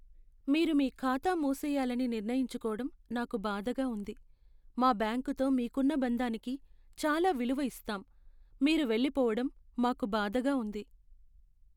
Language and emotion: Telugu, sad